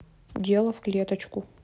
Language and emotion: Russian, neutral